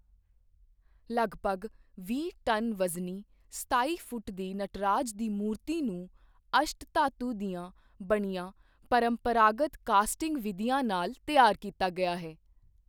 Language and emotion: Punjabi, neutral